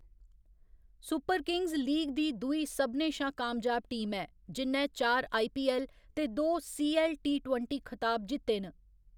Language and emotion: Dogri, neutral